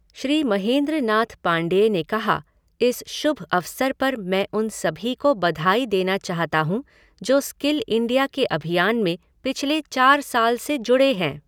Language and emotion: Hindi, neutral